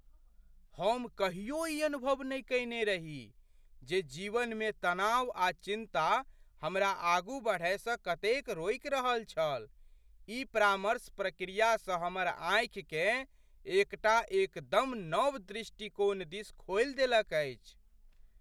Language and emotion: Maithili, surprised